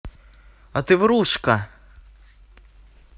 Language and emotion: Russian, angry